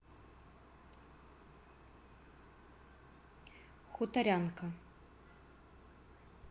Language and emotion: Russian, neutral